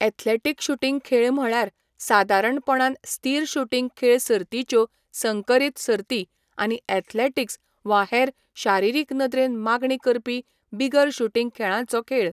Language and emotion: Goan Konkani, neutral